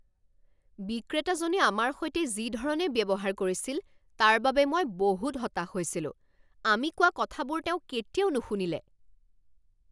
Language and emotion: Assamese, angry